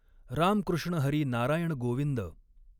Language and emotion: Marathi, neutral